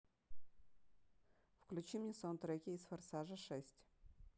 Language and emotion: Russian, neutral